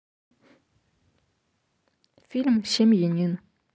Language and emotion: Russian, neutral